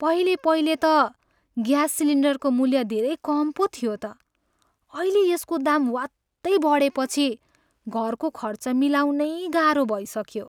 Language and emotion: Nepali, sad